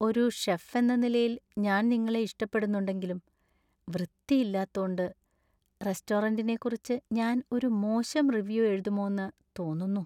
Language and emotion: Malayalam, sad